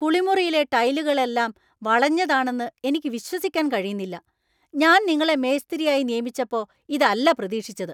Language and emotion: Malayalam, angry